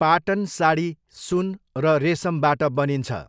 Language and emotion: Nepali, neutral